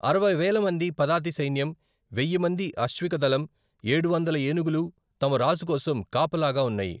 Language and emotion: Telugu, neutral